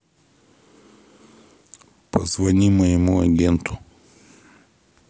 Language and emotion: Russian, neutral